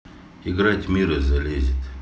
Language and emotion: Russian, neutral